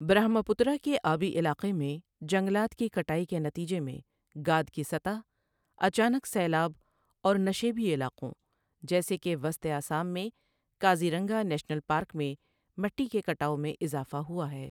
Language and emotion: Urdu, neutral